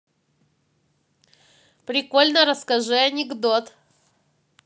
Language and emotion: Russian, positive